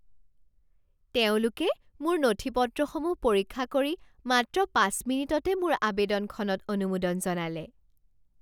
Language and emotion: Assamese, surprised